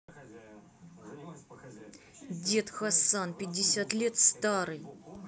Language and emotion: Russian, angry